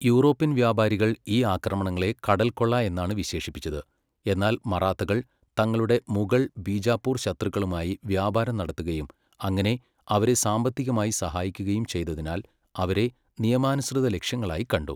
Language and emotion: Malayalam, neutral